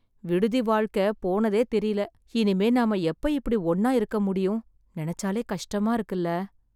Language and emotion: Tamil, sad